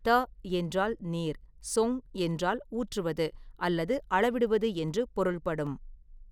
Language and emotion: Tamil, neutral